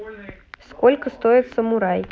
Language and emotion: Russian, neutral